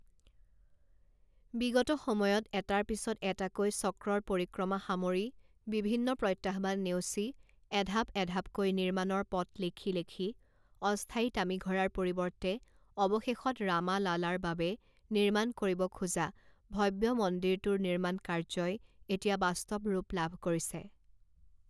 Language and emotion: Assamese, neutral